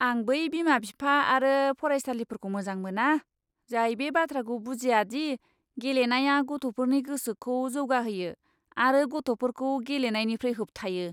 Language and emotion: Bodo, disgusted